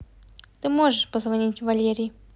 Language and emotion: Russian, neutral